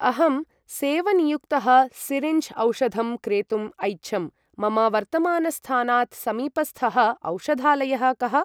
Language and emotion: Sanskrit, neutral